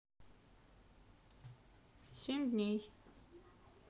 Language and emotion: Russian, neutral